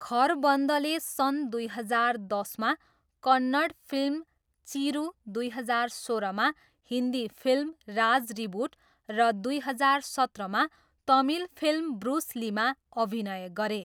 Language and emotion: Nepali, neutral